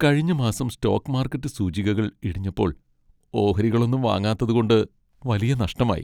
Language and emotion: Malayalam, sad